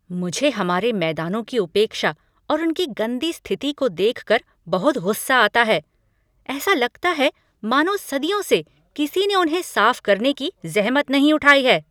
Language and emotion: Hindi, angry